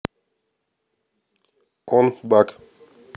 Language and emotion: Russian, neutral